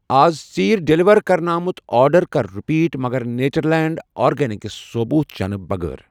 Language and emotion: Kashmiri, neutral